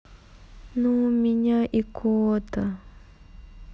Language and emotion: Russian, sad